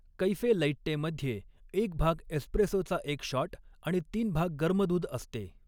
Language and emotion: Marathi, neutral